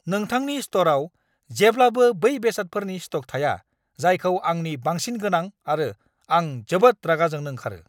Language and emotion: Bodo, angry